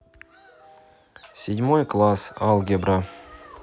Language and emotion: Russian, neutral